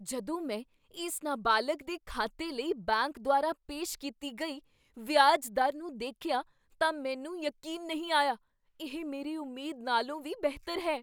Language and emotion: Punjabi, surprised